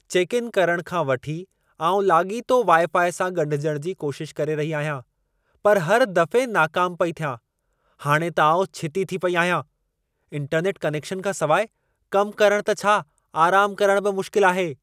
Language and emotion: Sindhi, angry